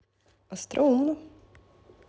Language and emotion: Russian, neutral